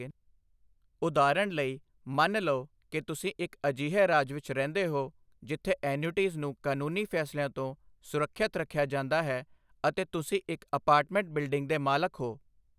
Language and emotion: Punjabi, neutral